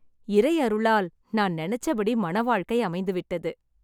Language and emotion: Tamil, happy